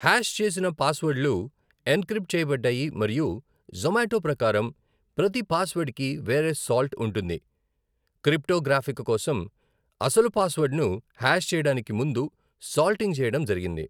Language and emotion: Telugu, neutral